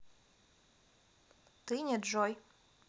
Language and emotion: Russian, neutral